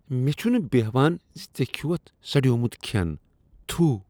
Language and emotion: Kashmiri, disgusted